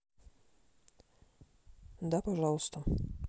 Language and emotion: Russian, neutral